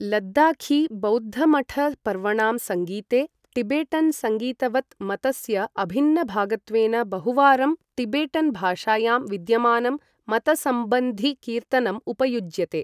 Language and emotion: Sanskrit, neutral